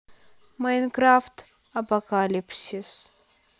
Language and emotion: Russian, neutral